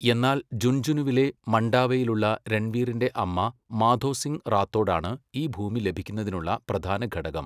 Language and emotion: Malayalam, neutral